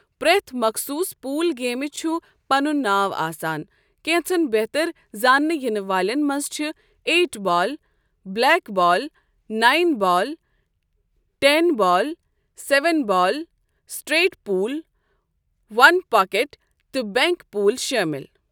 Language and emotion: Kashmiri, neutral